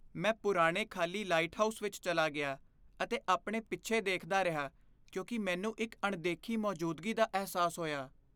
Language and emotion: Punjabi, fearful